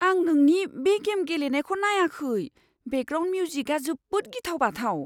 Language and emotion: Bodo, fearful